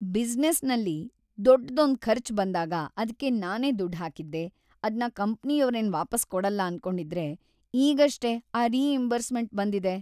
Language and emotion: Kannada, happy